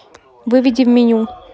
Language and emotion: Russian, neutral